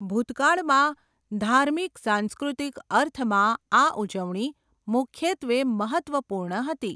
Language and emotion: Gujarati, neutral